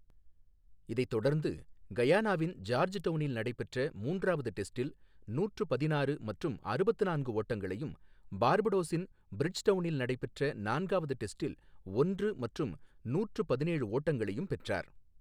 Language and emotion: Tamil, neutral